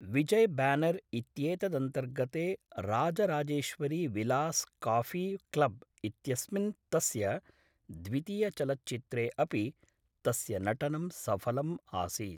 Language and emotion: Sanskrit, neutral